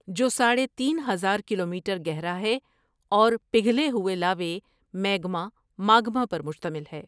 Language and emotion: Urdu, neutral